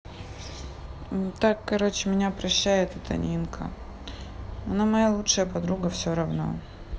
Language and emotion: Russian, sad